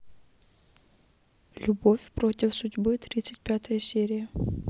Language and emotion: Russian, neutral